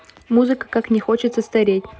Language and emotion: Russian, neutral